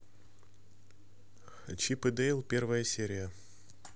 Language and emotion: Russian, neutral